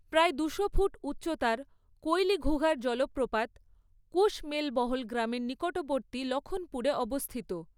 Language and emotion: Bengali, neutral